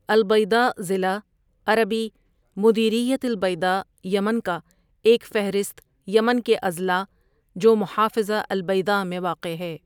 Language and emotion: Urdu, neutral